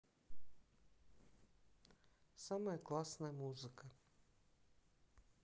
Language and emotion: Russian, neutral